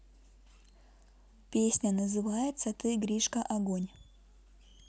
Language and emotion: Russian, neutral